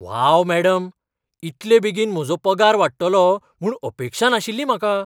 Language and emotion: Goan Konkani, surprised